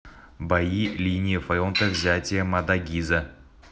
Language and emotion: Russian, neutral